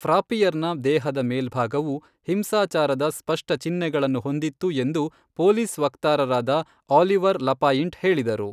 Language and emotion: Kannada, neutral